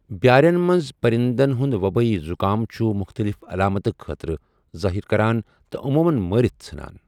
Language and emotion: Kashmiri, neutral